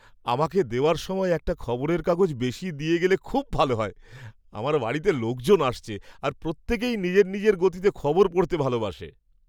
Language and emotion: Bengali, happy